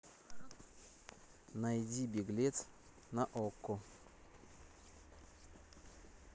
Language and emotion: Russian, neutral